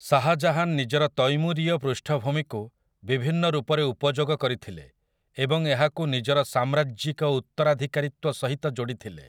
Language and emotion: Odia, neutral